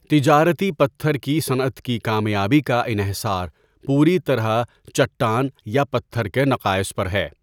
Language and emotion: Urdu, neutral